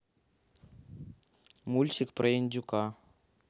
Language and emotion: Russian, neutral